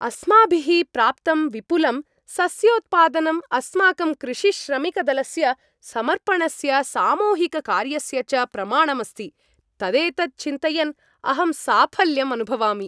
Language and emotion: Sanskrit, happy